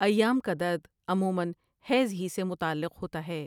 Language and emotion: Urdu, neutral